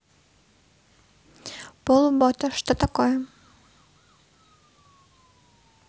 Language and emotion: Russian, neutral